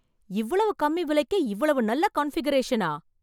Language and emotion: Tamil, surprised